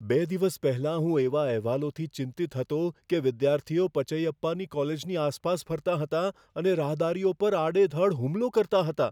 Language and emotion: Gujarati, fearful